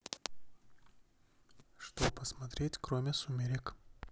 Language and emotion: Russian, neutral